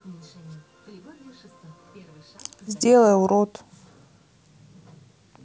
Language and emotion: Russian, neutral